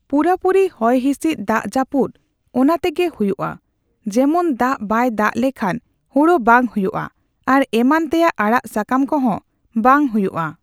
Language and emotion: Santali, neutral